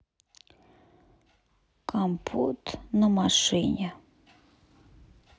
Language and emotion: Russian, sad